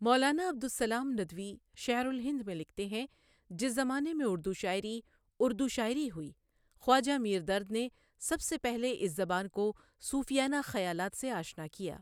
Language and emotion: Urdu, neutral